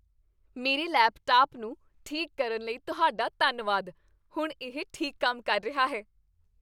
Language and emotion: Punjabi, happy